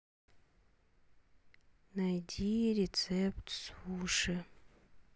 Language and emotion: Russian, sad